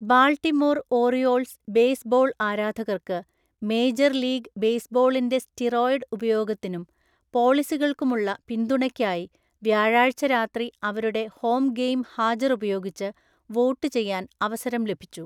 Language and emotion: Malayalam, neutral